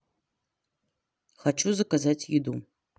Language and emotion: Russian, neutral